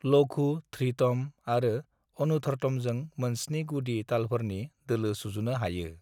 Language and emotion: Bodo, neutral